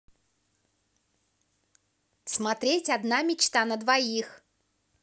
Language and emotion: Russian, positive